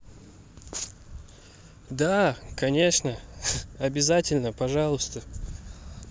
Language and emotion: Russian, positive